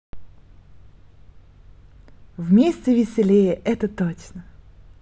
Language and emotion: Russian, positive